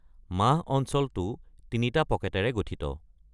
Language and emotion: Assamese, neutral